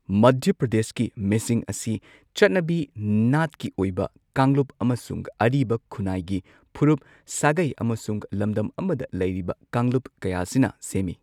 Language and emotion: Manipuri, neutral